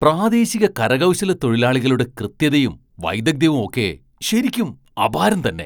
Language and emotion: Malayalam, surprised